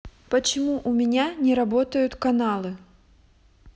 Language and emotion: Russian, neutral